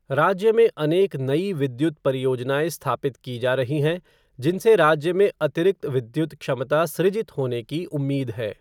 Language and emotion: Hindi, neutral